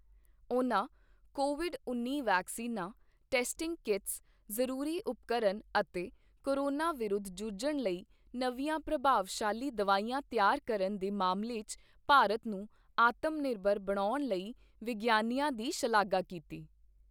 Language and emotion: Punjabi, neutral